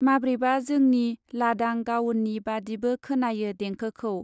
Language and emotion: Bodo, neutral